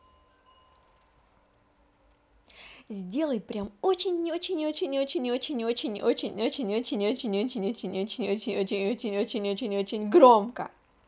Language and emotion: Russian, positive